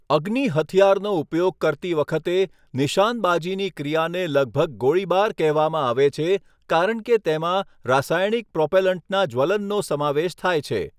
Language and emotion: Gujarati, neutral